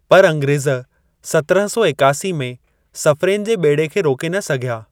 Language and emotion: Sindhi, neutral